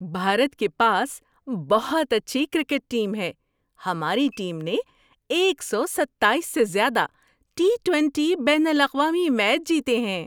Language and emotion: Urdu, happy